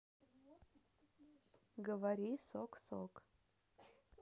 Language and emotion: Russian, neutral